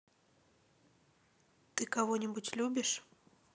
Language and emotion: Russian, sad